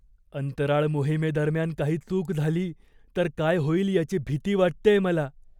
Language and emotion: Marathi, fearful